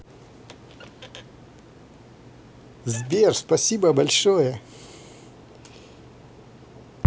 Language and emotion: Russian, positive